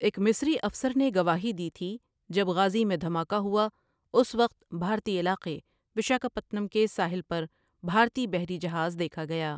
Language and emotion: Urdu, neutral